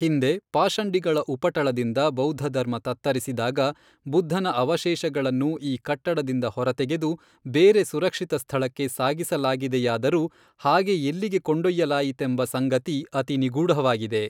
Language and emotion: Kannada, neutral